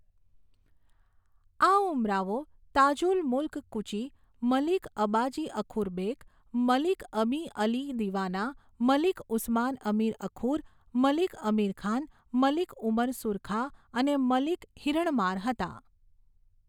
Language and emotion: Gujarati, neutral